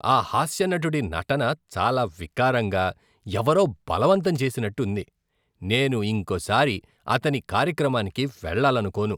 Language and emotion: Telugu, disgusted